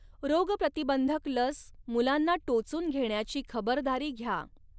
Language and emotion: Marathi, neutral